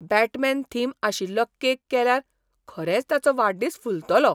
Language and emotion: Goan Konkani, surprised